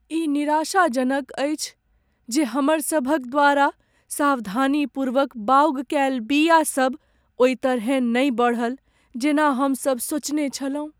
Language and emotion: Maithili, sad